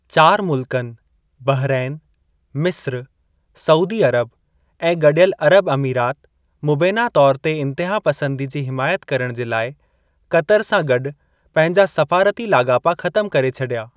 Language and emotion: Sindhi, neutral